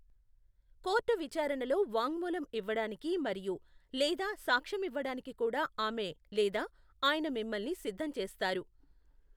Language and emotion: Telugu, neutral